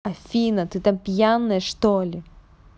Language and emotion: Russian, angry